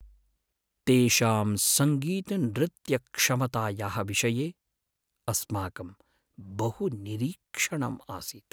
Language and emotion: Sanskrit, sad